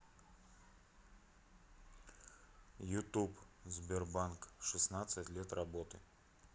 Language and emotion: Russian, neutral